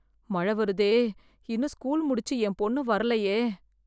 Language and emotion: Tamil, fearful